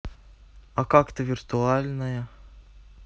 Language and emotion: Russian, neutral